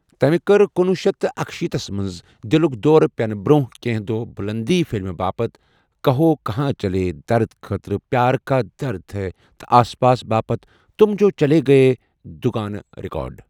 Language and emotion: Kashmiri, neutral